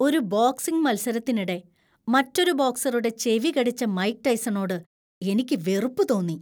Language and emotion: Malayalam, disgusted